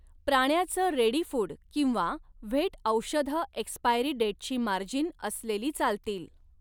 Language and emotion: Marathi, neutral